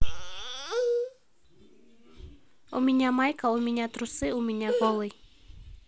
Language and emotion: Russian, neutral